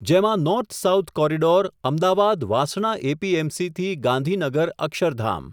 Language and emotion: Gujarati, neutral